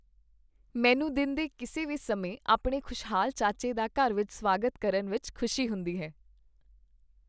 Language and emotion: Punjabi, happy